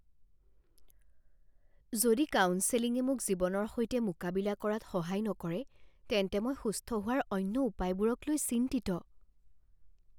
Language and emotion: Assamese, fearful